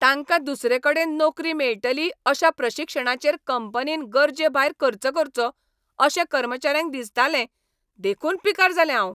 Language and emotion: Goan Konkani, angry